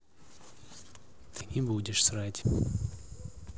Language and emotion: Russian, neutral